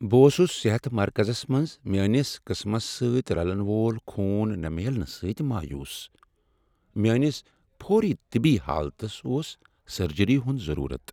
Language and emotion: Kashmiri, sad